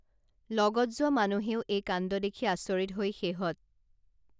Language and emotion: Assamese, neutral